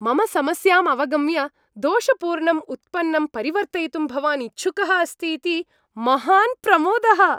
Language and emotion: Sanskrit, happy